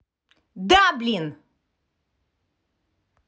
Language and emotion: Russian, angry